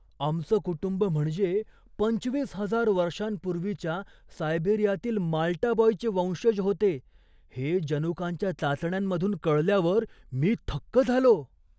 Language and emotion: Marathi, surprised